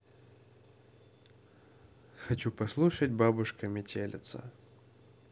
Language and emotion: Russian, neutral